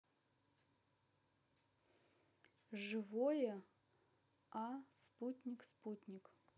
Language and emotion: Russian, neutral